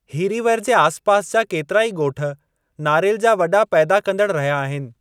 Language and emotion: Sindhi, neutral